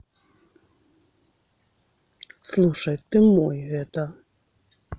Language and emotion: Russian, neutral